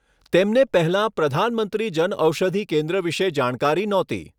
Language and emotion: Gujarati, neutral